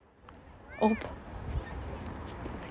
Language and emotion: Russian, neutral